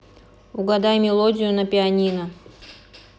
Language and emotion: Russian, neutral